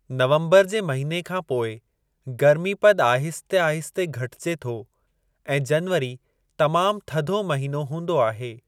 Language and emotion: Sindhi, neutral